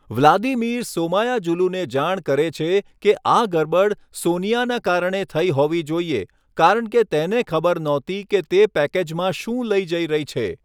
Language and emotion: Gujarati, neutral